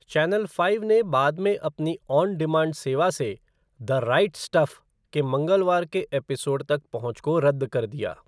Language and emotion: Hindi, neutral